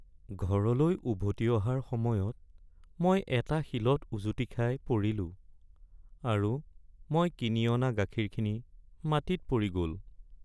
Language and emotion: Assamese, sad